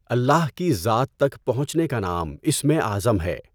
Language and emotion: Urdu, neutral